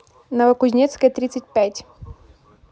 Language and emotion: Russian, neutral